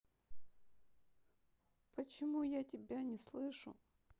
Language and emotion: Russian, sad